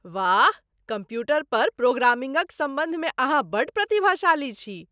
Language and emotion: Maithili, surprised